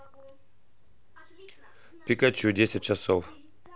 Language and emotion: Russian, neutral